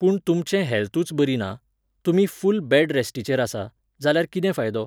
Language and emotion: Goan Konkani, neutral